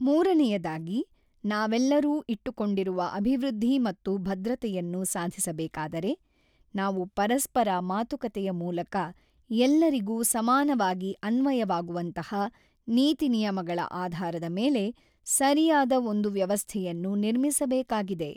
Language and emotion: Kannada, neutral